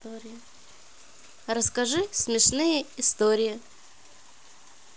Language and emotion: Russian, positive